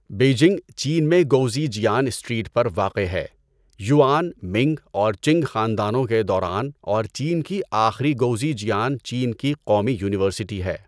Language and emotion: Urdu, neutral